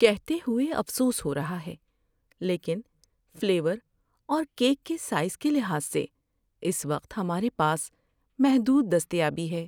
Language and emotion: Urdu, sad